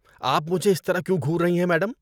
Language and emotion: Urdu, disgusted